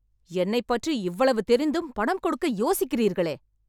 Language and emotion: Tamil, angry